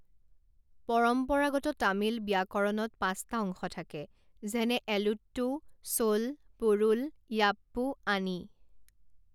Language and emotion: Assamese, neutral